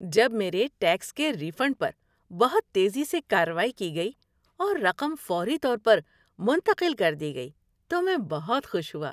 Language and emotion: Urdu, happy